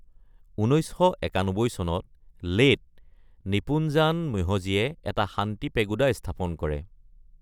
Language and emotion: Assamese, neutral